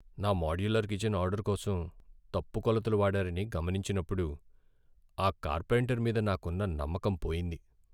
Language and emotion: Telugu, sad